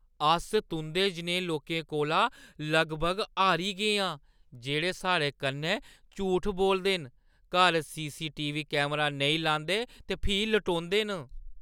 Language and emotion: Dogri, disgusted